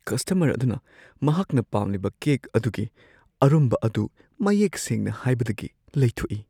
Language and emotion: Manipuri, fearful